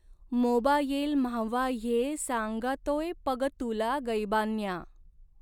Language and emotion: Marathi, neutral